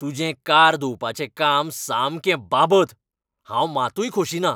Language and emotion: Goan Konkani, angry